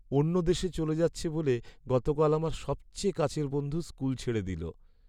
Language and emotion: Bengali, sad